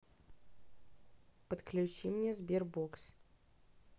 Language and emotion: Russian, neutral